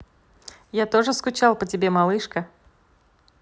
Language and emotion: Russian, positive